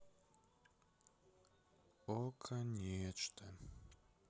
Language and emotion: Russian, sad